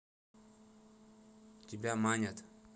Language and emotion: Russian, neutral